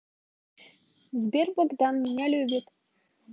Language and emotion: Russian, positive